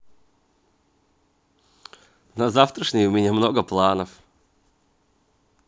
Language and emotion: Russian, neutral